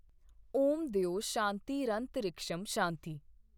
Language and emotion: Punjabi, neutral